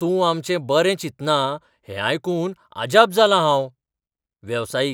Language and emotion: Goan Konkani, surprised